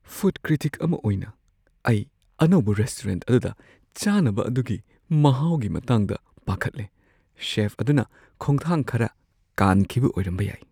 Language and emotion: Manipuri, fearful